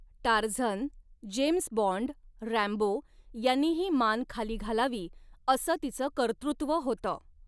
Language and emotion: Marathi, neutral